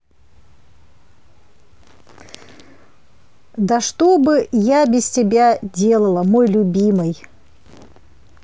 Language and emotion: Russian, positive